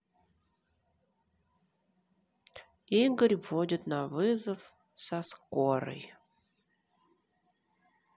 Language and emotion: Russian, neutral